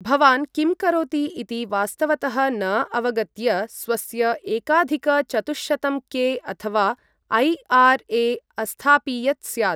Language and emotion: Sanskrit, neutral